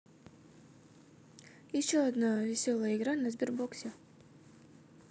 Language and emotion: Russian, neutral